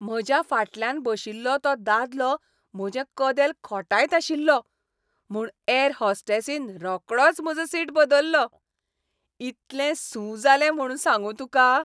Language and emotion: Goan Konkani, happy